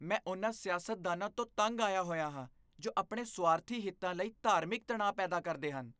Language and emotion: Punjabi, disgusted